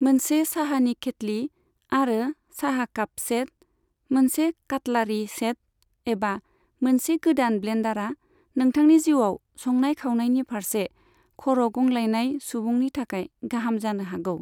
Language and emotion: Bodo, neutral